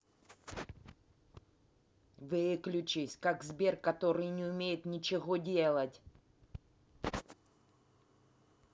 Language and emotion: Russian, angry